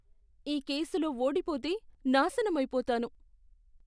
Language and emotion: Telugu, fearful